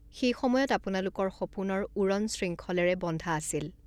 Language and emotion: Assamese, neutral